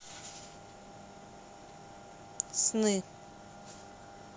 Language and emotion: Russian, neutral